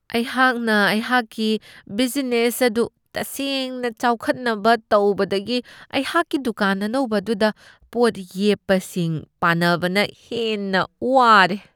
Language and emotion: Manipuri, disgusted